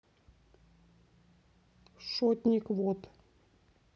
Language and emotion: Russian, neutral